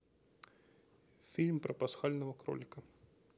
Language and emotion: Russian, neutral